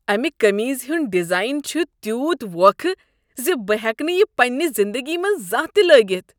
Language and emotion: Kashmiri, disgusted